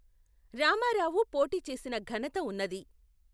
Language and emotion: Telugu, neutral